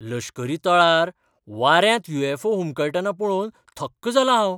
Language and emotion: Goan Konkani, surprised